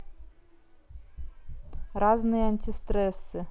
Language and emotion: Russian, neutral